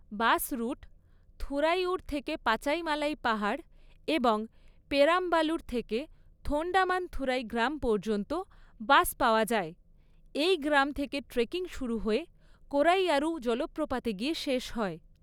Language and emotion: Bengali, neutral